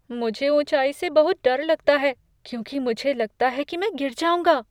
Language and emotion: Hindi, fearful